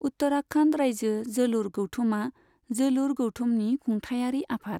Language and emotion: Bodo, neutral